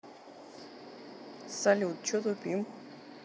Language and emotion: Russian, neutral